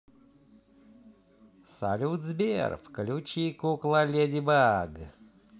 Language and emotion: Russian, positive